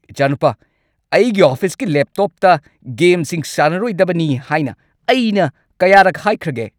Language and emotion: Manipuri, angry